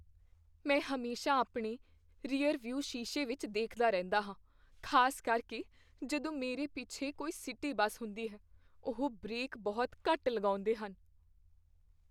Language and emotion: Punjabi, fearful